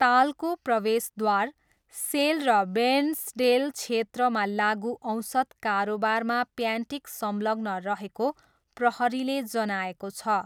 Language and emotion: Nepali, neutral